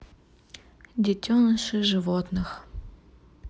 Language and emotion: Russian, neutral